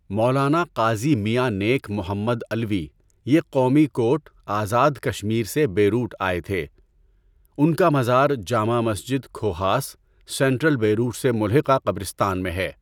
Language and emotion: Urdu, neutral